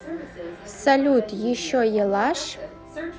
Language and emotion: Russian, neutral